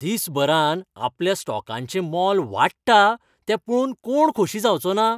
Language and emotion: Goan Konkani, happy